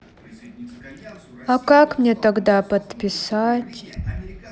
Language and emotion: Russian, sad